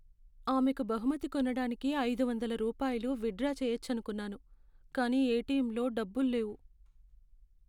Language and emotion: Telugu, sad